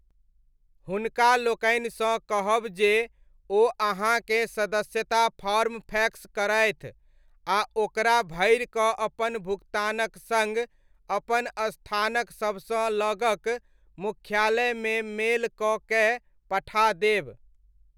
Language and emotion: Maithili, neutral